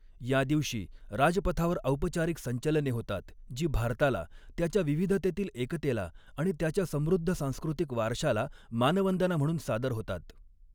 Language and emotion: Marathi, neutral